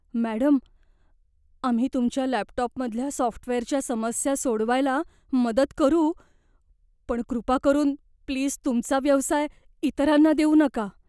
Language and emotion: Marathi, fearful